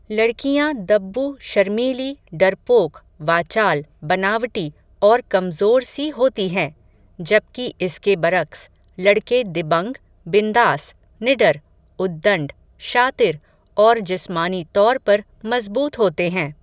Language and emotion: Hindi, neutral